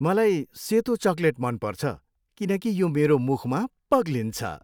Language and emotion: Nepali, happy